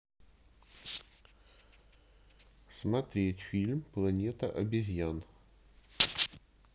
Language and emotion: Russian, neutral